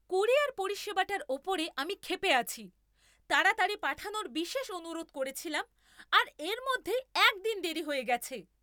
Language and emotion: Bengali, angry